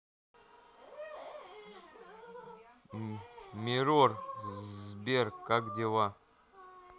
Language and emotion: Russian, neutral